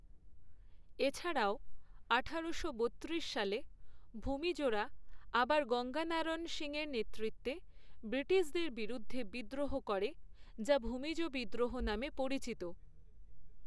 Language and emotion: Bengali, neutral